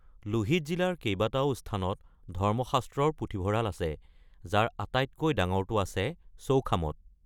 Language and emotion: Assamese, neutral